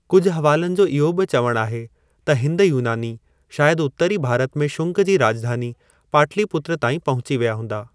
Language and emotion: Sindhi, neutral